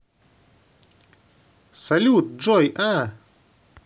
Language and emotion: Russian, positive